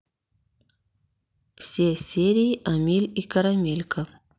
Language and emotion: Russian, neutral